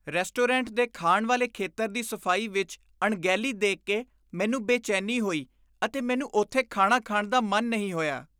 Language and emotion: Punjabi, disgusted